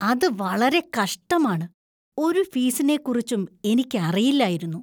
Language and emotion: Malayalam, disgusted